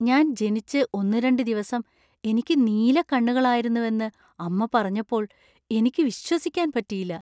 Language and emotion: Malayalam, surprised